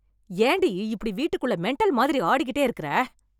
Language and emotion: Tamil, angry